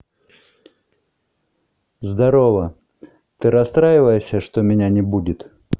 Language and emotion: Russian, neutral